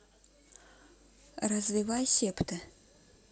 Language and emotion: Russian, neutral